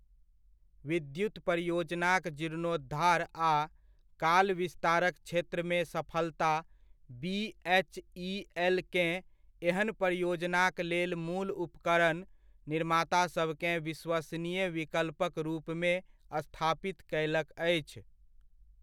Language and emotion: Maithili, neutral